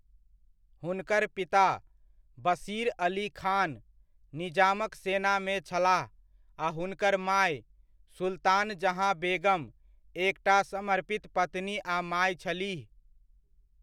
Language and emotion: Maithili, neutral